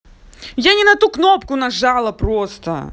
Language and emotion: Russian, angry